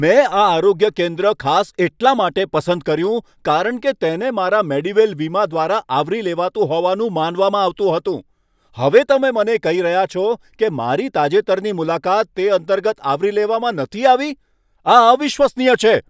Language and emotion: Gujarati, angry